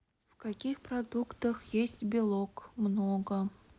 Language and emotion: Russian, neutral